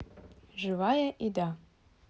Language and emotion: Russian, neutral